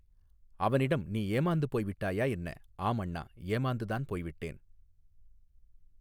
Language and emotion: Tamil, neutral